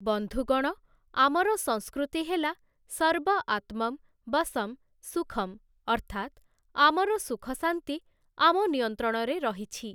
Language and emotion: Odia, neutral